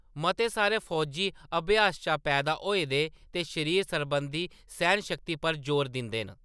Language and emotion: Dogri, neutral